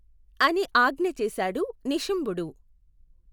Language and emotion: Telugu, neutral